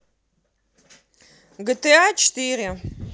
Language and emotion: Russian, positive